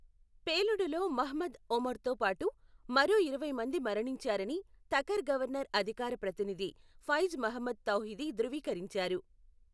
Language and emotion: Telugu, neutral